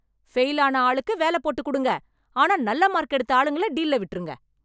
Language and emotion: Tamil, angry